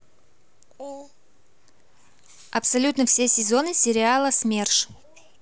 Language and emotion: Russian, neutral